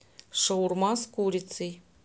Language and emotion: Russian, neutral